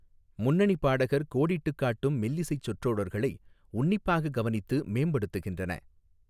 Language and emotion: Tamil, neutral